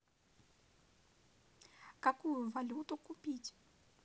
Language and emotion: Russian, neutral